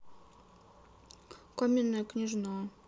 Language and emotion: Russian, sad